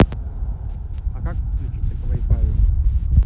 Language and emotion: Russian, neutral